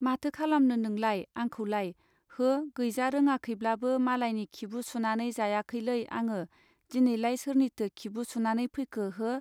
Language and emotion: Bodo, neutral